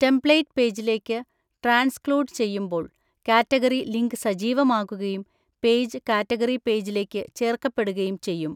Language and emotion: Malayalam, neutral